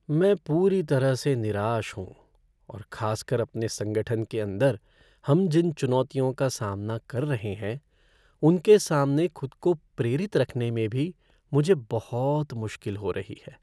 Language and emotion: Hindi, sad